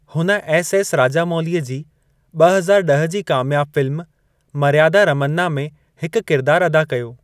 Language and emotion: Sindhi, neutral